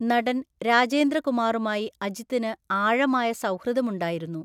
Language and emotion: Malayalam, neutral